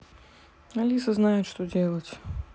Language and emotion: Russian, neutral